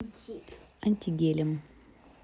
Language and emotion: Russian, neutral